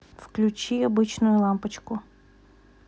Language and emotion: Russian, neutral